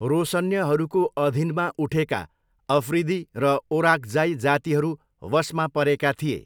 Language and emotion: Nepali, neutral